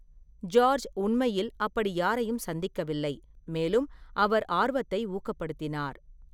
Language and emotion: Tamil, neutral